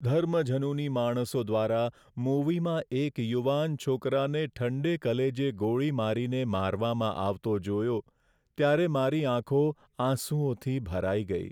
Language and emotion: Gujarati, sad